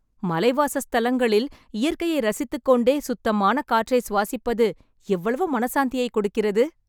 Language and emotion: Tamil, happy